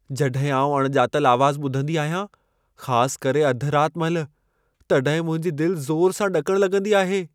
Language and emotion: Sindhi, fearful